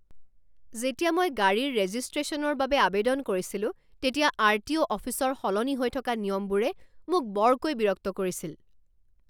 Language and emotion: Assamese, angry